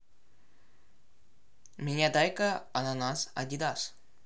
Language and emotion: Russian, neutral